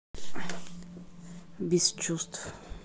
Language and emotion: Russian, neutral